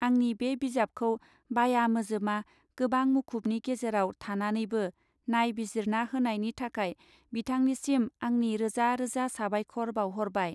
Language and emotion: Bodo, neutral